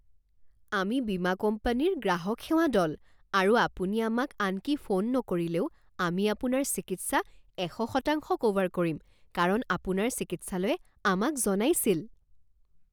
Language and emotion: Assamese, surprised